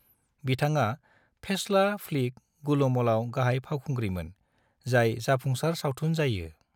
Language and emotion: Bodo, neutral